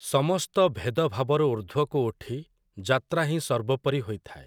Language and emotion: Odia, neutral